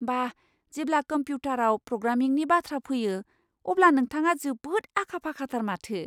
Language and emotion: Bodo, surprised